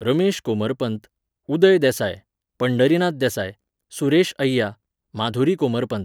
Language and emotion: Goan Konkani, neutral